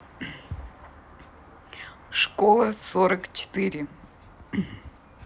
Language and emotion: Russian, neutral